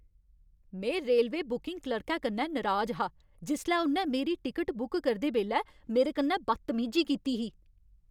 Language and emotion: Dogri, angry